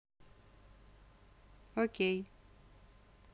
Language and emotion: Russian, neutral